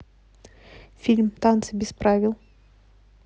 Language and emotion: Russian, neutral